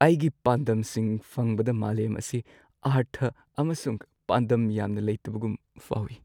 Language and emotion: Manipuri, sad